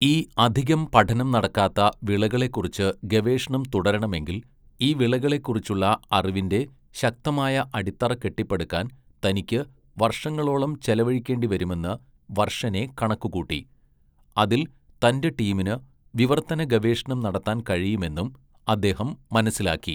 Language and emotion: Malayalam, neutral